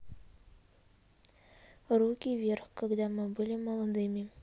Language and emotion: Russian, neutral